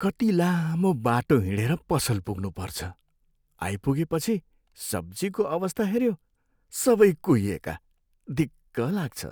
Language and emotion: Nepali, sad